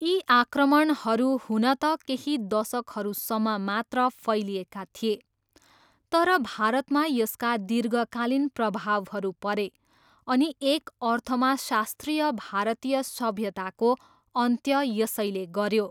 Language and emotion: Nepali, neutral